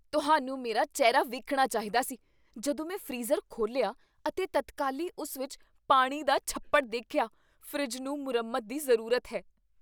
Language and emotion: Punjabi, surprised